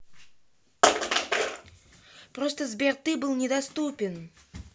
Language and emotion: Russian, angry